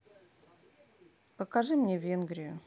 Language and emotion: Russian, neutral